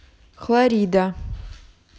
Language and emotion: Russian, neutral